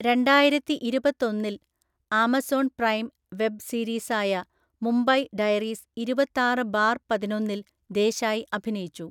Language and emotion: Malayalam, neutral